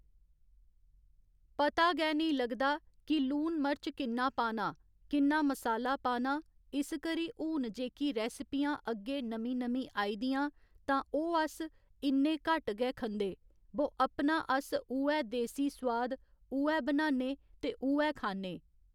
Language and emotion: Dogri, neutral